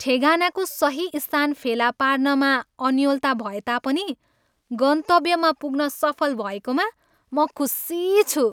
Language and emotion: Nepali, happy